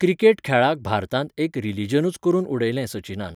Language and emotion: Goan Konkani, neutral